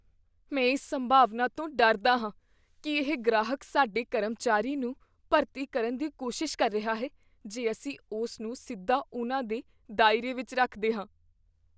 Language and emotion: Punjabi, fearful